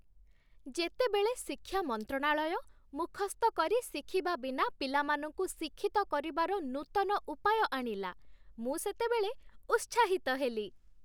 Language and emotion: Odia, happy